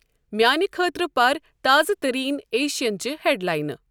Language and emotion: Kashmiri, neutral